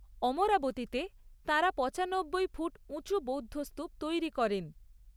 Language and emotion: Bengali, neutral